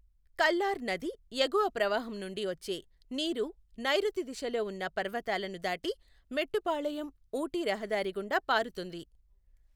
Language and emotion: Telugu, neutral